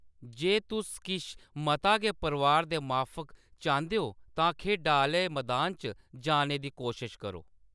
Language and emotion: Dogri, neutral